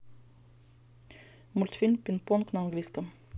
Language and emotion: Russian, neutral